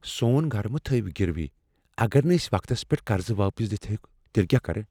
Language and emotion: Kashmiri, fearful